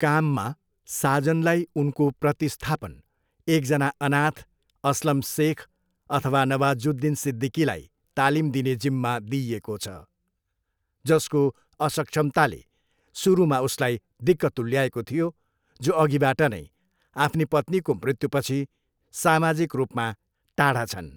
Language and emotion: Nepali, neutral